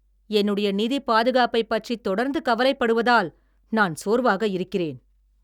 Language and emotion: Tamil, angry